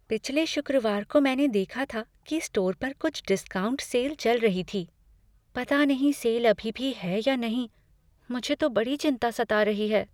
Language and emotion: Hindi, fearful